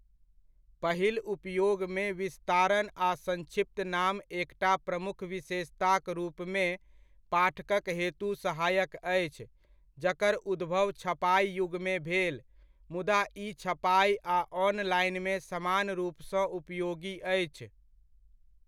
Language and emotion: Maithili, neutral